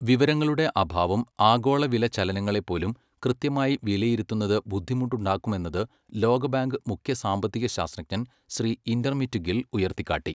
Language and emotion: Malayalam, neutral